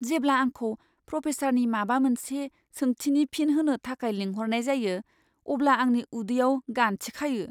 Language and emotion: Bodo, fearful